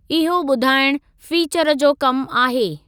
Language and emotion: Sindhi, neutral